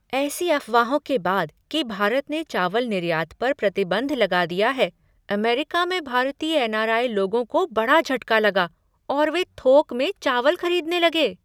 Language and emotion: Hindi, surprised